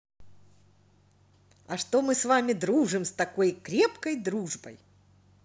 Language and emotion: Russian, positive